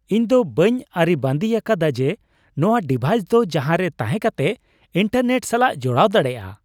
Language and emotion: Santali, surprised